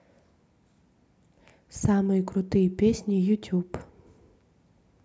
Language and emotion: Russian, neutral